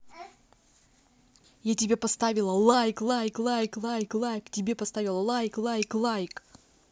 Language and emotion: Russian, angry